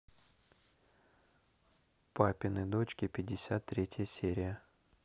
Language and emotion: Russian, neutral